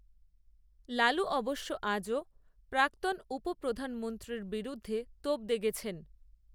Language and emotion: Bengali, neutral